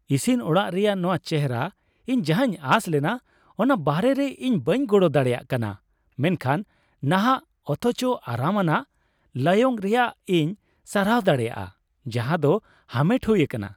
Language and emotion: Santali, happy